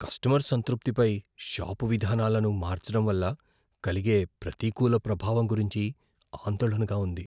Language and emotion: Telugu, fearful